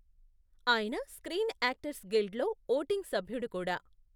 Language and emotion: Telugu, neutral